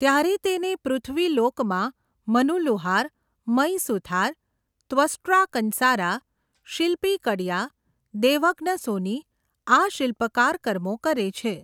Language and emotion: Gujarati, neutral